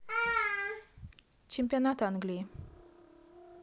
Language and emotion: Russian, neutral